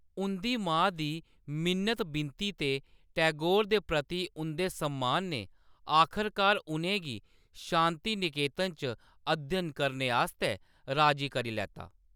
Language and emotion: Dogri, neutral